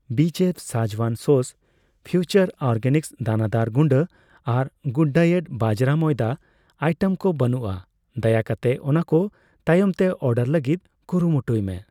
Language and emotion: Santali, neutral